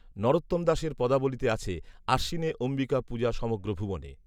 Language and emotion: Bengali, neutral